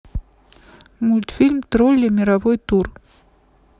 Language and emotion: Russian, neutral